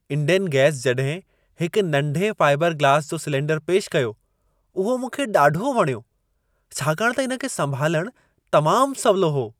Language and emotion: Sindhi, happy